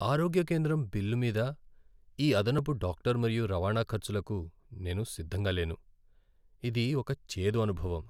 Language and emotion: Telugu, sad